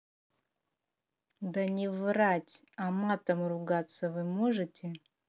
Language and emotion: Russian, angry